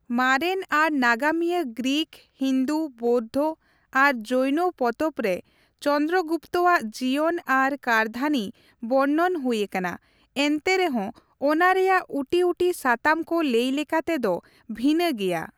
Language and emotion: Santali, neutral